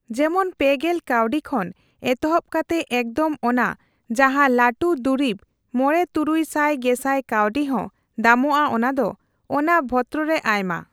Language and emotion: Santali, neutral